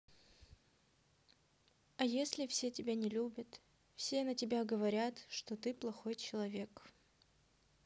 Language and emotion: Russian, sad